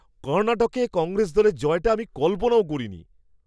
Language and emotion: Bengali, surprised